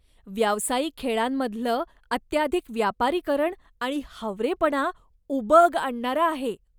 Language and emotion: Marathi, disgusted